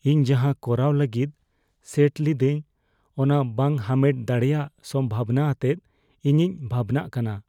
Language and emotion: Santali, fearful